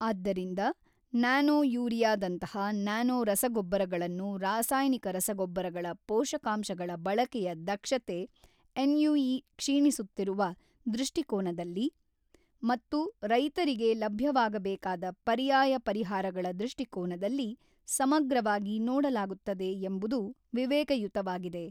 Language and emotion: Kannada, neutral